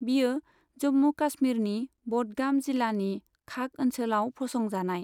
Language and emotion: Bodo, neutral